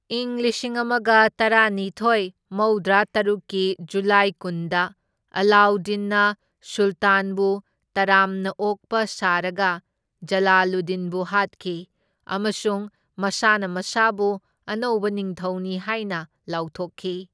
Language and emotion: Manipuri, neutral